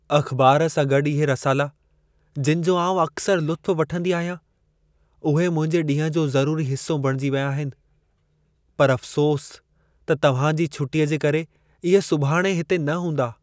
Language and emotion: Sindhi, sad